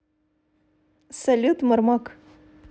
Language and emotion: Russian, positive